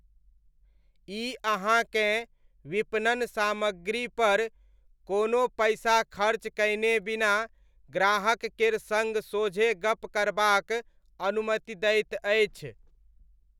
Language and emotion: Maithili, neutral